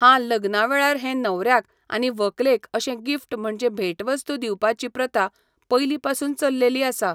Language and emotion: Goan Konkani, neutral